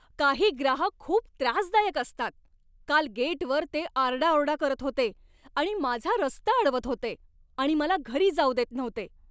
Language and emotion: Marathi, angry